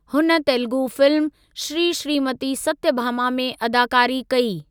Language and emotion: Sindhi, neutral